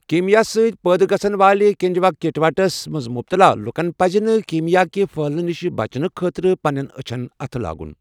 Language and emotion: Kashmiri, neutral